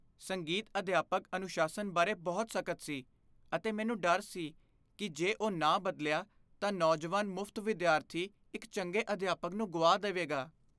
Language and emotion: Punjabi, fearful